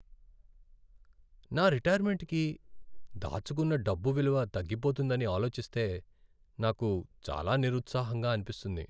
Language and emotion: Telugu, sad